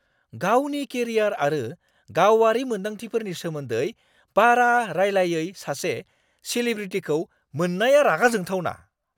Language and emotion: Bodo, angry